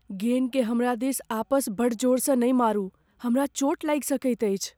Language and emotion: Maithili, fearful